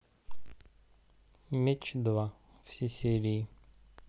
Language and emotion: Russian, neutral